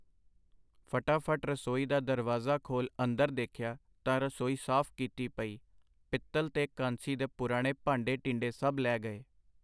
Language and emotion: Punjabi, neutral